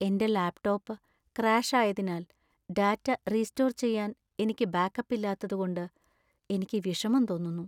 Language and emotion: Malayalam, sad